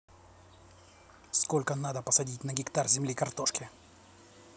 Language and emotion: Russian, neutral